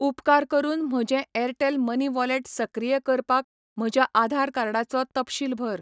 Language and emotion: Goan Konkani, neutral